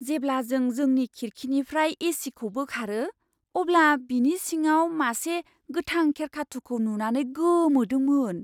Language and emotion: Bodo, surprised